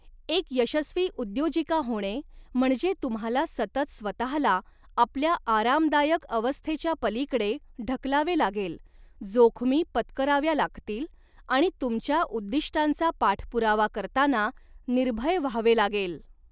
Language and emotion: Marathi, neutral